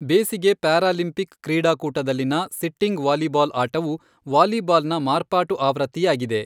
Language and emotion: Kannada, neutral